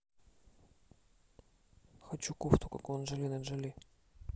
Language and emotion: Russian, neutral